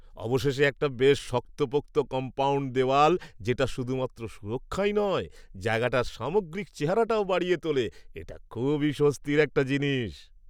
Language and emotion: Bengali, happy